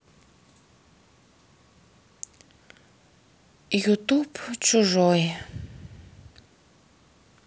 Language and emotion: Russian, sad